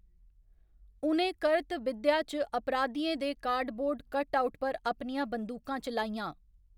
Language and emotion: Dogri, neutral